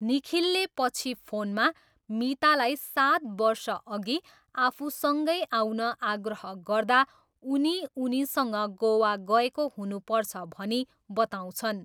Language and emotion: Nepali, neutral